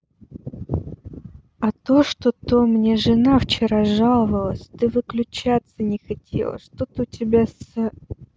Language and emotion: Russian, neutral